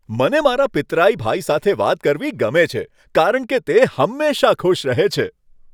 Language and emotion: Gujarati, happy